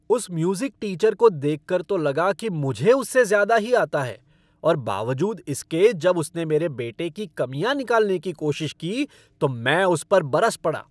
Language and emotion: Hindi, angry